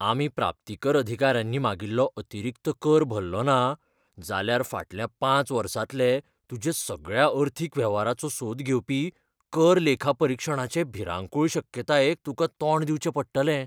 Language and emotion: Goan Konkani, fearful